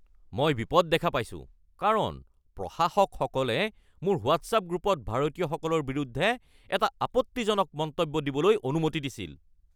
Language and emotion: Assamese, angry